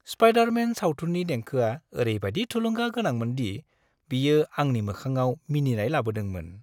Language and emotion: Bodo, happy